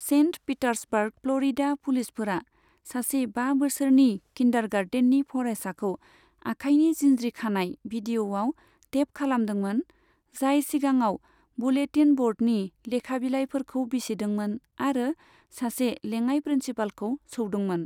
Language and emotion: Bodo, neutral